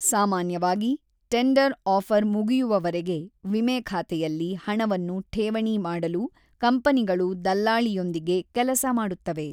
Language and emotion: Kannada, neutral